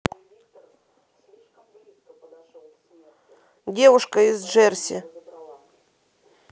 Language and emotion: Russian, neutral